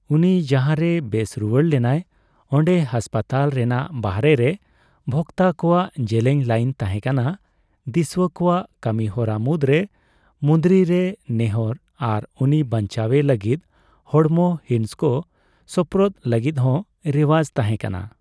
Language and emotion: Santali, neutral